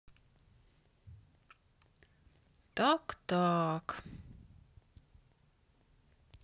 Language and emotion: Russian, sad